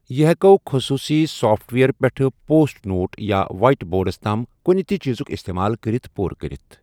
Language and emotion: Kashmiri, neutral